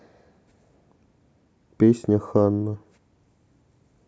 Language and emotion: Russian, neutral